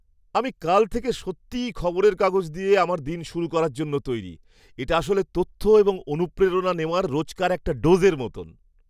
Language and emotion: Bengali, happy